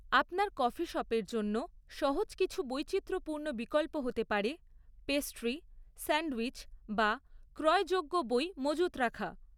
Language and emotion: Bengali, neutral